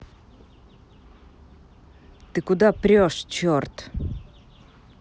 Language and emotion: Russian, angry